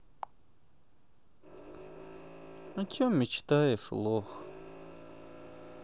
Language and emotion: Russian, sad